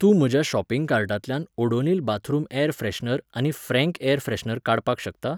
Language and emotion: Goan Konkani, neutral